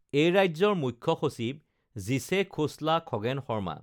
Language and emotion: Assamese, neutral